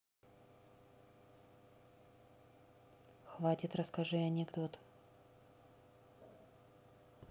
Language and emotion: Russian, neutral